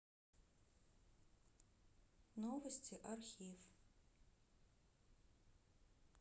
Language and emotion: Russian, neutral